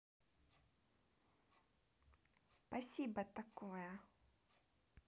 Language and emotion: Russian, positive